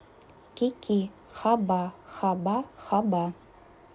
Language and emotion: Russian, neutral